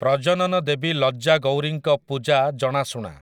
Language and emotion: Odia, neutral